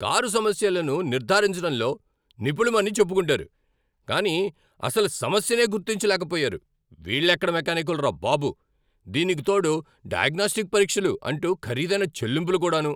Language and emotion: Telugu, angry